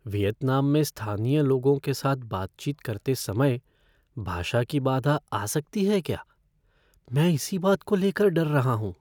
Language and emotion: Hindi, fearful